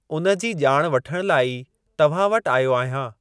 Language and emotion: Sindhi, neutral